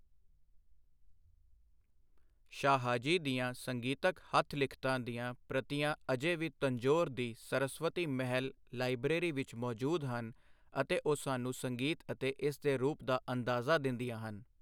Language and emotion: Punjabi, neutral